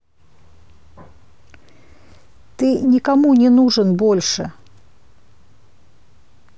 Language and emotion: Russian, angry